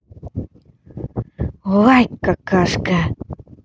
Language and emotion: Russian, positive